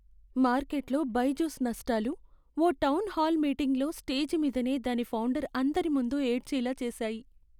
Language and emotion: Telugu, sad